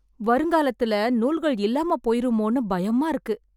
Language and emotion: Tamil, fearful